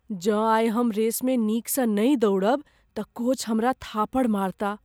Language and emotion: Maithili, fearful